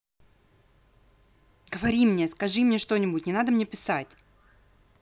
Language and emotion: Russian, angry